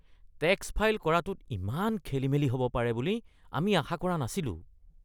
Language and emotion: Assamese, disgusted